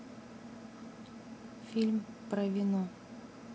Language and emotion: Russian, neutral